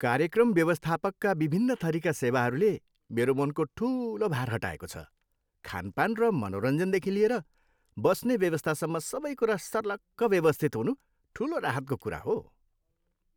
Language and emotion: Nepali, happy